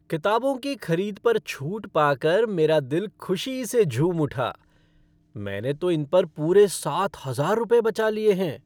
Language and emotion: Hindi, happy